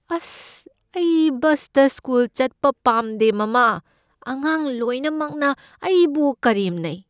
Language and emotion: Manipuri, fearful